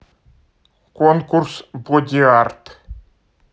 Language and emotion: Russian, neutral